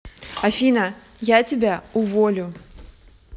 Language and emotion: Russian, angry